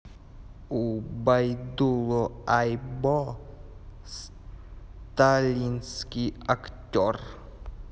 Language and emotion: Russian, neutral